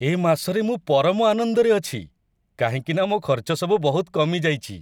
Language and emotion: Odia, happy